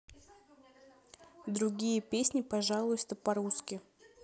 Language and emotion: Russian, neutral